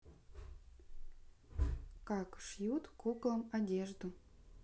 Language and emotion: Russian, neutral